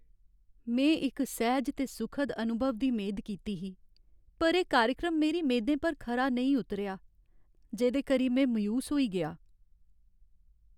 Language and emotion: Dogri, sad